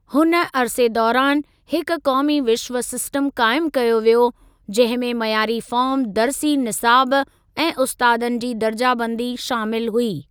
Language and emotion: Sindhi, neutral